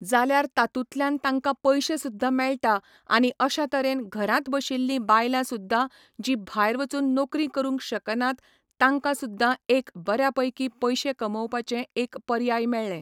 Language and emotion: Goan Konkani, neutral